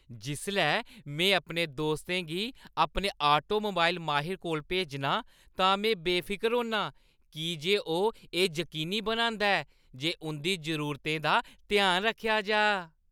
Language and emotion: Dogri, happy